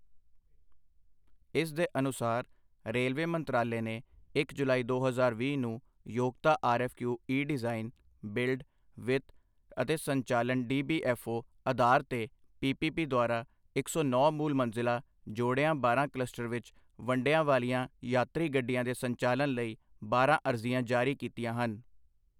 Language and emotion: Punjabi, neutral